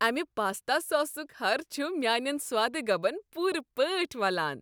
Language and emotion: Kashmiri, happy